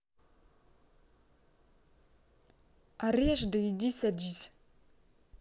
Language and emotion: Russian, angry